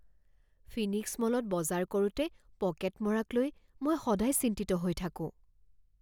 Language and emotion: Assamese, fearful